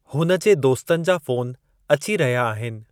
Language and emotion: Sindhi, neutral